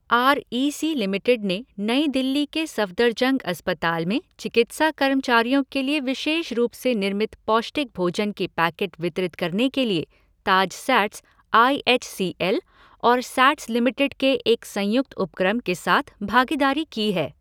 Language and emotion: Hindi, neutral